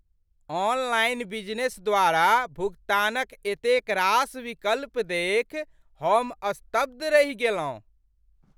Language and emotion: Maithili, surprised